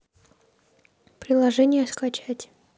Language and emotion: Russian, neutral